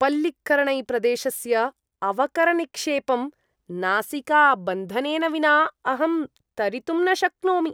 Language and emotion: Sanskrit, disgusted